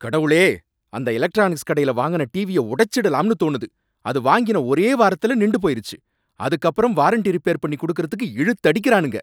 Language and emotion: Tamil, angry